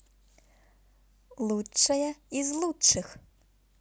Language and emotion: Russian, positive